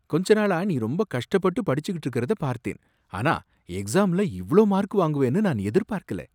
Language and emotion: Tamil, surprised